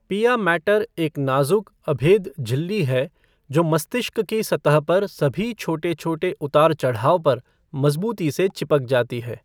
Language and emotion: Hindi, neutral